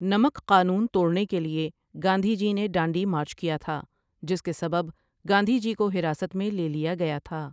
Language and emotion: Urdu, neutral